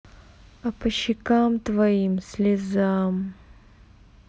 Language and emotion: Russian, neutral